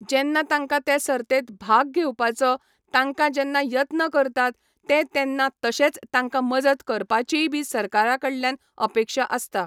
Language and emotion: Goan Konkani, neutral